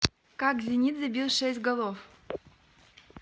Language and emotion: Russian, neutral